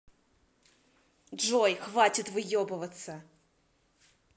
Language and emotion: Russian, angry